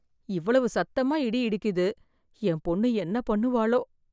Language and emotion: Tamil, fearful